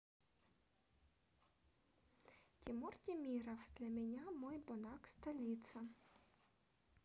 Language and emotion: Russian, neutral